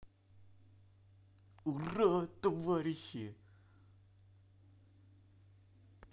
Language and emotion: Russian, positive